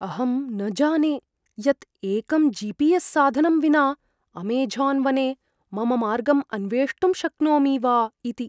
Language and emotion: Sanskrit, fearful